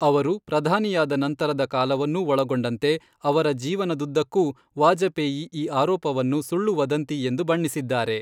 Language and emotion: Kannada, neutral